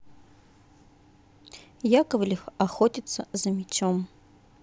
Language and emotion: Russian, neutral